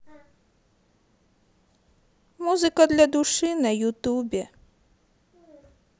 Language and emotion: Russian, sad